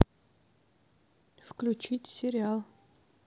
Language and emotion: Russian, neutral